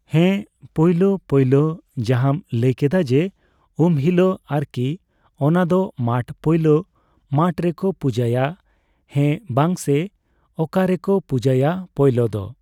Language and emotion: Santali, neutral